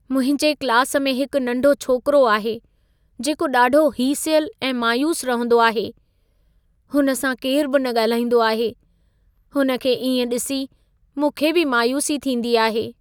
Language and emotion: Sindhi, sad